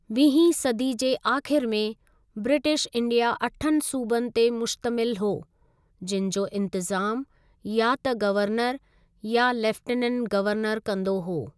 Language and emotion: Sindhi, neutral